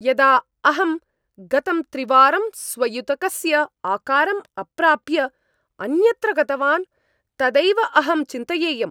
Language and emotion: Sanskrit, angry